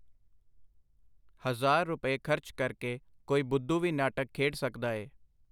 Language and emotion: Punjabi, neutral